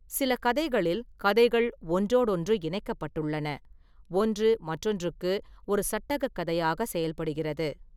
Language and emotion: Tamil, neutral